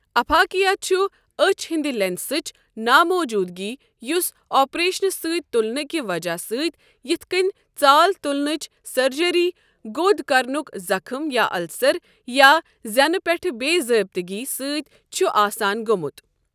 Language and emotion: Kashmiri, neutral